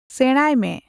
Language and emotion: Santali, neutral